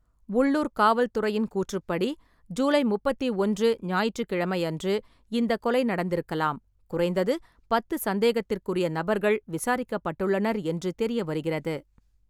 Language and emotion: Tamil, neutral